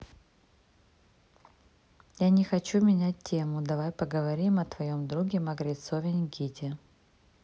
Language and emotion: Russian, neutral